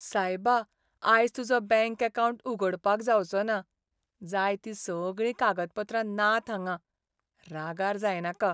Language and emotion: Goan Konkani, sad